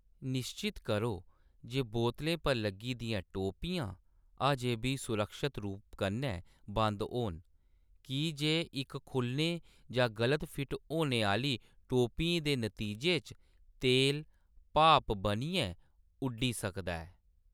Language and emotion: Dogri, neutral